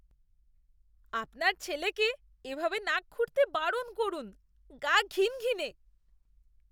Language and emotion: Bengali, disgusted